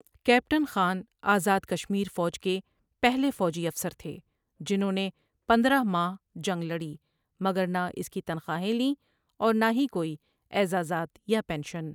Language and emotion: Urdu, neutral